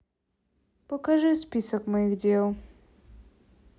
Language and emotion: Russian, sad